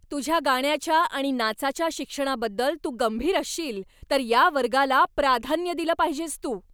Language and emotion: Marathi, angry